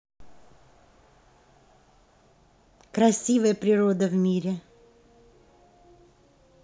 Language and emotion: Russian, positive